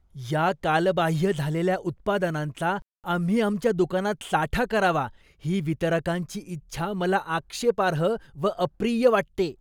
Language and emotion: Marathi, disgusted